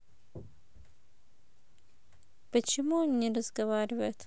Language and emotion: Russian, neutral